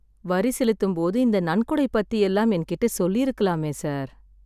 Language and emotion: Tamil, sad